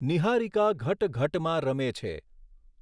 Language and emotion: Gujarati, neutral